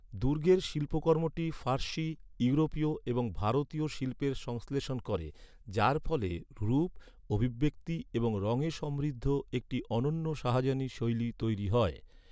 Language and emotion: Bengali, neutral